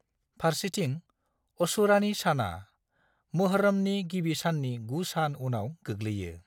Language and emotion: Bodo, neutral